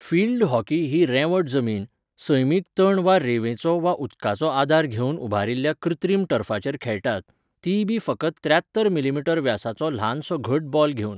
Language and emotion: Goan Konkani, neutral